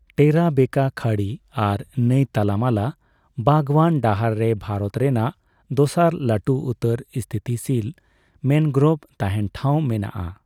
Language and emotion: Santali, neutral